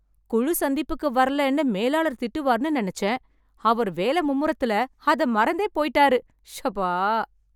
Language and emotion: Tamil, happy